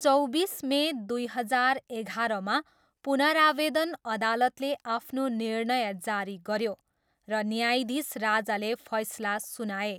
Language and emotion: Nepali, neutral